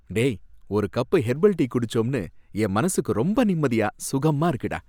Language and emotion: Tamil, happy